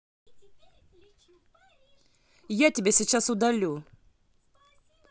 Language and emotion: Russian, angry